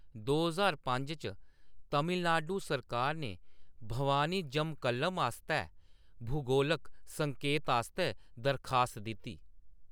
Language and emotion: Dogri, neutral